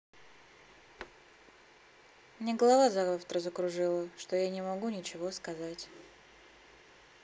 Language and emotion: Russian, neutral